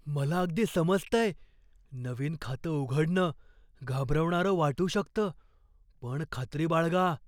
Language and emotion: Marathi, fearful